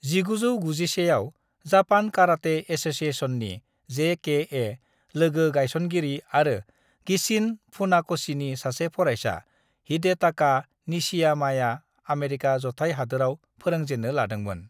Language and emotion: Bodo, neutral